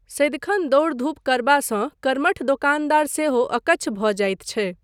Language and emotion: Maithili, neutral